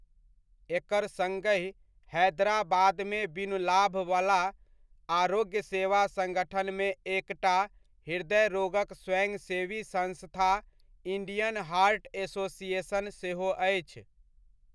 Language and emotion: Maithili, neutral